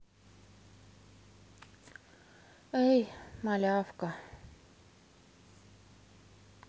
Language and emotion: Russian, sad